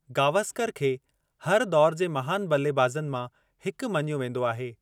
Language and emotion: Sindhi, neutral